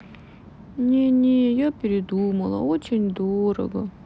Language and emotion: Russian, sad